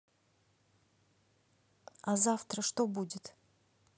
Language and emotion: Russian, neutral